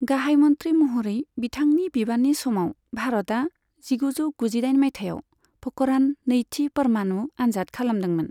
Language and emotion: Bodo, neutral